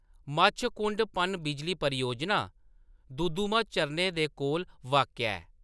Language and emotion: Dogri, neutral